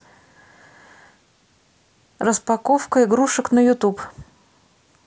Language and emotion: Russian, neutral